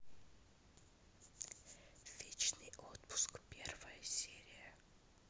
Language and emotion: Russian, neutral